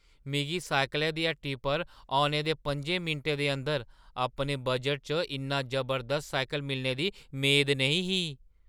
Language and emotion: Dogri, surprised